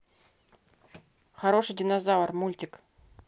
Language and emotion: Russian, neutral